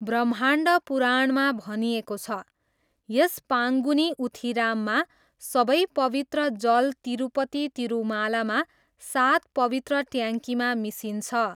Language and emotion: Nepali, neutral